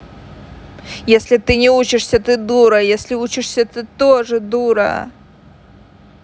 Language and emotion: Russian, angry